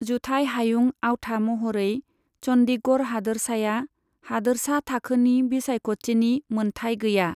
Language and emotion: Bodo, neutral